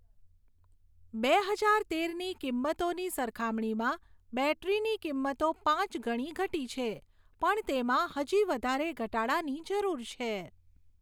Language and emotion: Gujarati, neutral